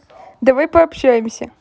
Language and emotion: Russian, positive